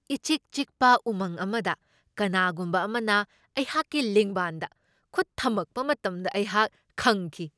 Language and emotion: Manipuri, surprised